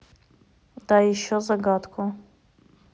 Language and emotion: Russian, neutral